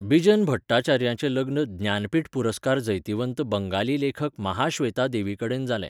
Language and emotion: Goan Konkani, neutral